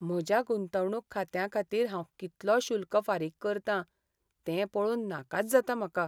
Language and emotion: Goan Konkani, sad